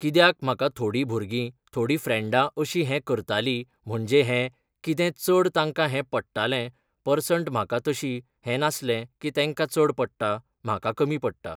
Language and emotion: Goan Konkani, neutral